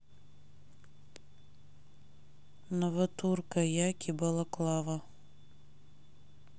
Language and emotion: Russian, neutral